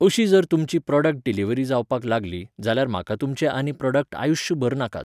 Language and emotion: Goan Konkani, neutral